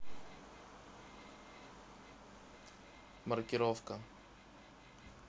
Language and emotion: Russian, neutral